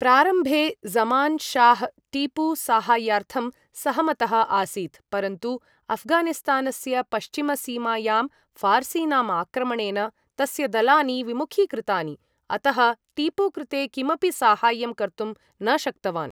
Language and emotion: Sanskrit, neutral